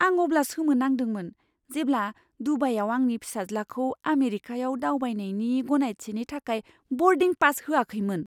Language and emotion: Bodo, surprised